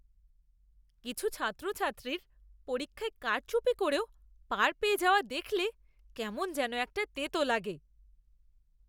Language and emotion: Bengali, disgusted